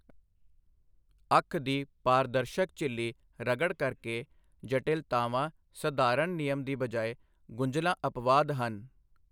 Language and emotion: Punjabi, neutral